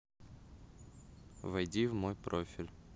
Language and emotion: Russian, neutral